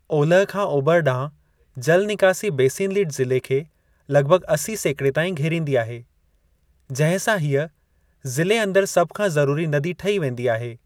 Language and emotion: Sindhi, neutral